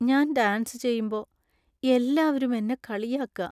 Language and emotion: Malayalam, sad